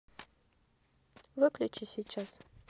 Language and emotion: Russian, neutral